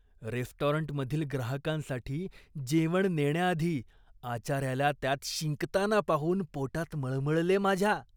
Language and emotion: Marathi, disgusted